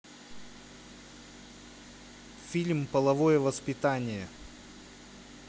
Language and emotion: Russian, neutral